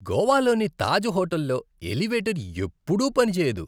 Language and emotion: Telugu, disgusted